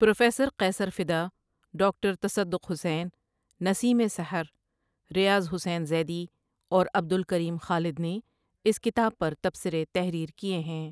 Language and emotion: Urdu, neutral